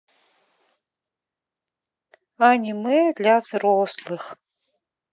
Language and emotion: Russian, sad